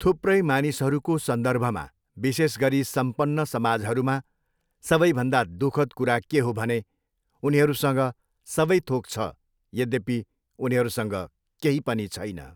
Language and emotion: Nepali, neutral